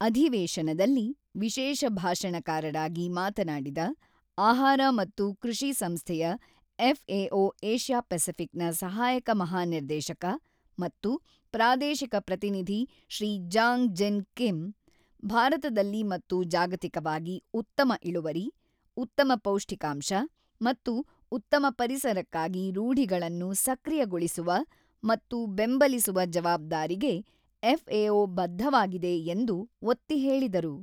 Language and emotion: Kannada, neutral